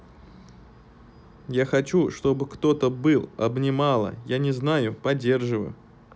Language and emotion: Russian, neutral